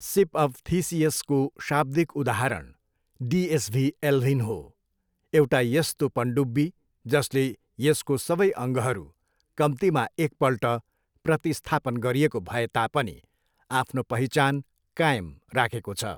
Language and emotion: Nepali, neutral